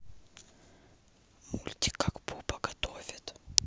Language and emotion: Russian, neutral